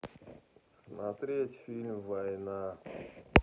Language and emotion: Russian, sad